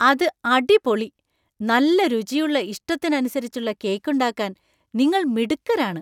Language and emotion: Malayalam, surprised